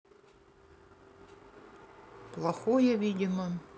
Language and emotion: Russian, neutral